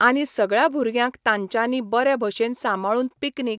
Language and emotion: Goan Konkani, neutral